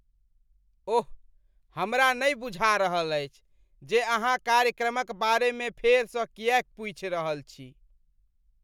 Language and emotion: Maithili, disgusted